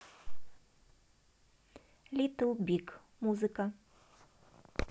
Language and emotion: Russian, neutral